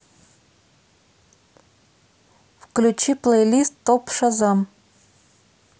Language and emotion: Russian, neutral